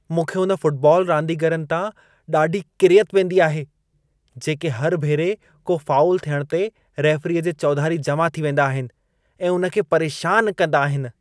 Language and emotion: Sindhi, disgusted